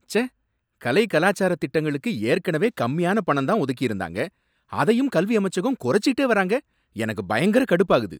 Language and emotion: Tamil, angry